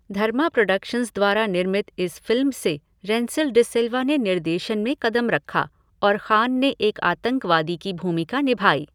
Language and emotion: Hindi, neutral